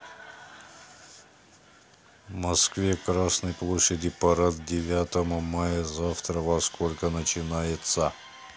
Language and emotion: Russian, neutral